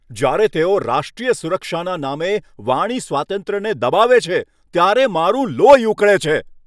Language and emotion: Gujarati, angry